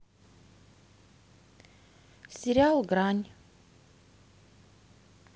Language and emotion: Russian, neutral